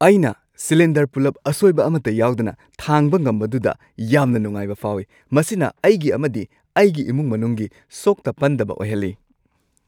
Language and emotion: Manipuri, happy